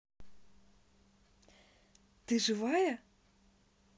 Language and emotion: Russian, positive